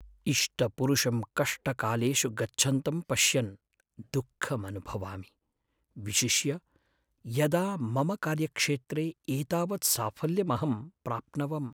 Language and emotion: Sanskrit, sad